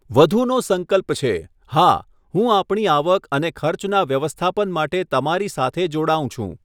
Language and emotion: Gujarati, neutral